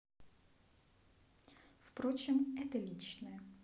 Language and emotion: Russian, neutral